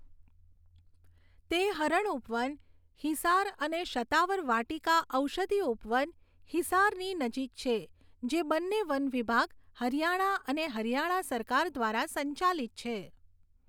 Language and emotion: Gujarati, neutral